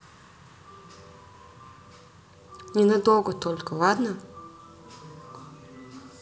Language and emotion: Russian, neutral